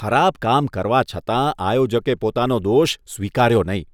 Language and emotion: Gujarati, disgusted